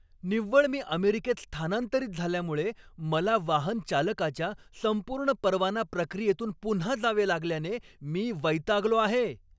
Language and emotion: Marathi, angry